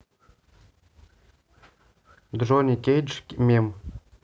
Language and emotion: Russian, neutral